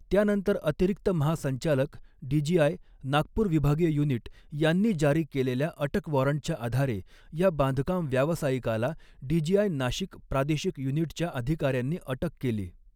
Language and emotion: Marathi, neutral